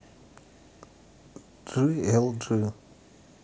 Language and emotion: Russian, neutral